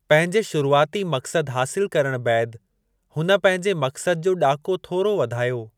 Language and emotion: Sindhi, neutral